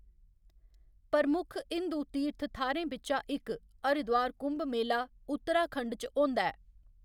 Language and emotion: Dogri, neutral